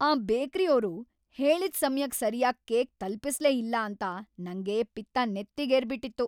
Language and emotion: Kannada, angry